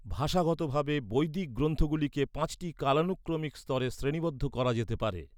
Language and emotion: Bengali, neutral